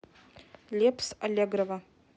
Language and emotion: Russian, neutral